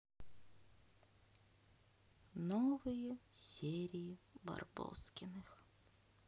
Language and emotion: Russian, sad